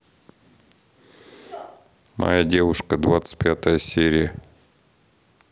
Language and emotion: Russian, neutral